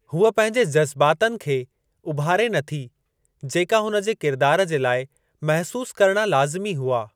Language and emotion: Sindhi, neutral